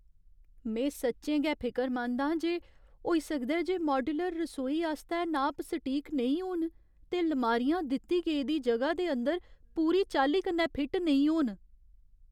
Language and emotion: Dogri, fearful